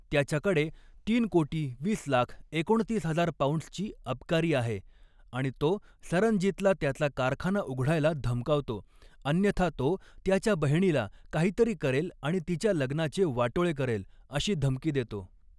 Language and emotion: Marathi, neutral